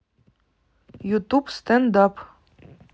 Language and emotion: Russian, neutral